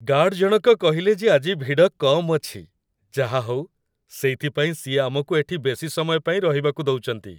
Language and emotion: Odia, happy